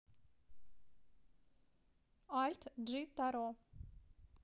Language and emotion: Russian, neutral